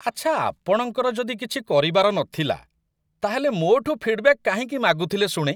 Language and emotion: Odia, disgusted